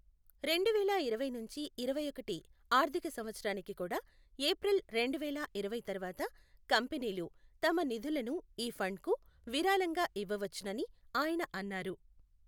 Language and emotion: Telugu, neutral